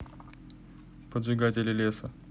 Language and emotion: Russian, neutral